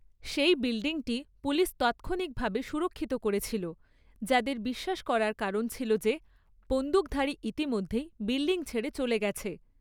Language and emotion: Bengali, neutral